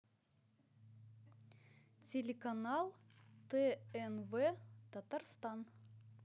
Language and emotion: Russian, neutral